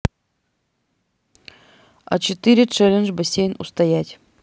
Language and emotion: Russian, neutral